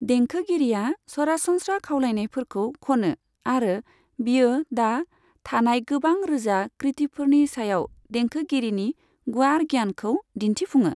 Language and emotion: Bodo, neutral